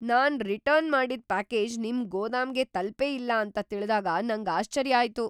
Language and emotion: Kannada, surprised